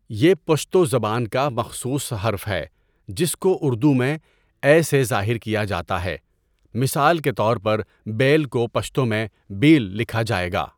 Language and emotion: Urdu, neutral